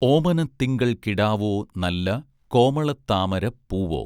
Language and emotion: Malayalam, neutral